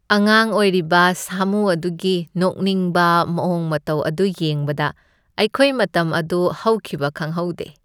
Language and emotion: Manipuri, happy